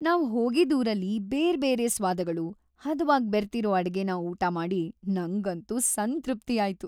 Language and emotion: Kannada, happy